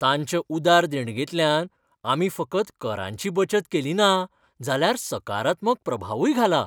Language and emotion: Goan Konkani, happy